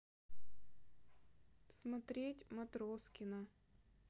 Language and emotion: Russian, sad